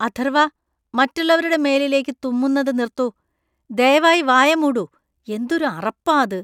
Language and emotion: Malayalam, disgusted